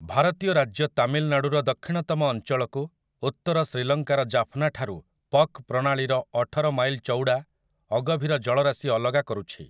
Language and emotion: Odia, neutral